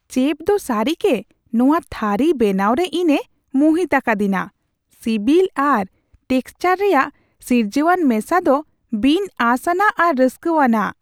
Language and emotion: Santali, surprised